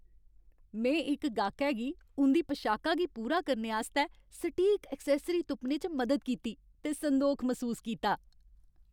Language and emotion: Dogri, happy